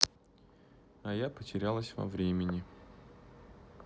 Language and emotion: Russian, sad